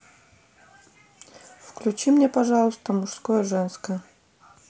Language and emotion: Russian, neutral